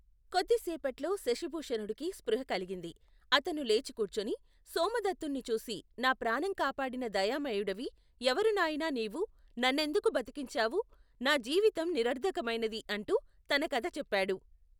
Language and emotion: Telugu, neutral